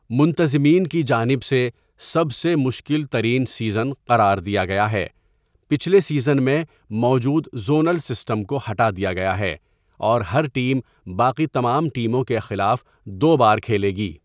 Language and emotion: Urdu, neutral